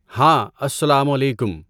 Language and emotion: Urdu, neutral